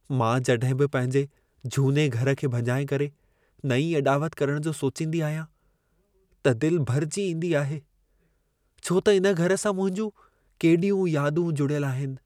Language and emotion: Sindhi, sad